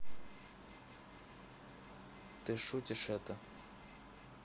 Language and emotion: Russian, neutral